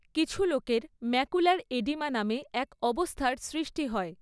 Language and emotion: Bengali, neutral